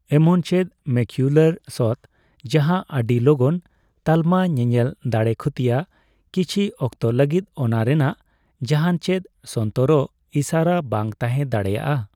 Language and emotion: Santali, neutral